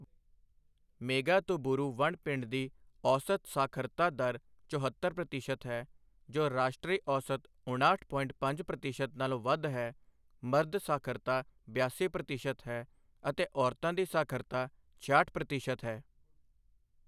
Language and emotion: Punjabi, neutral